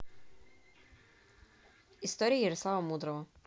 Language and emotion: Russian, neutral